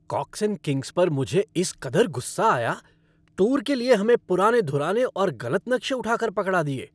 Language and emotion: Hindi, angry